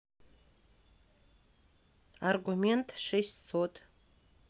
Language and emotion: Russian, neutral